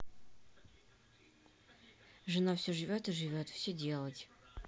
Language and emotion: Russian, neutral